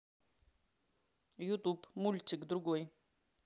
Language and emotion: Russian, neutral